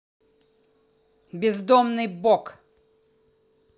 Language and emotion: Russian, angry